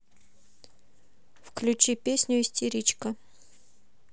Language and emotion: Russian, neutral